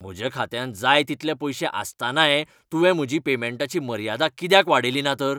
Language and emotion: Goan Konkani, angry